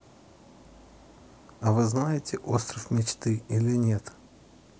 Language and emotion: Russian, neutral